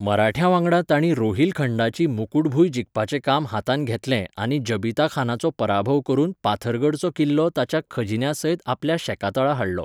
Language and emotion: Goan Konkani, neutral